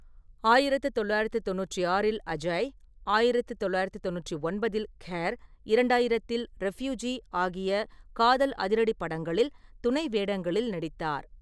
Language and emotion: Tamil, neutral